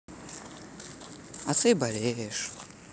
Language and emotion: Russian, sad